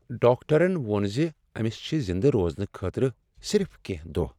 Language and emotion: Kashmiri, sad